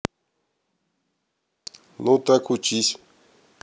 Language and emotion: Russian, neutral